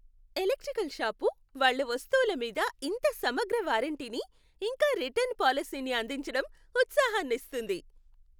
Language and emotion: Telugu, happy